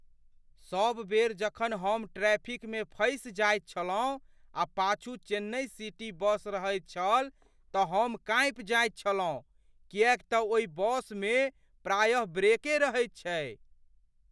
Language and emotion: Maithili, fearful